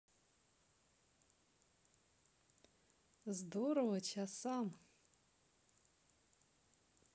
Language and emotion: Russian, positive